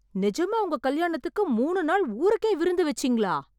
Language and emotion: Tamil, surprised